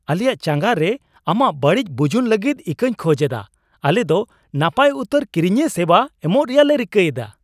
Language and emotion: Santali, surprised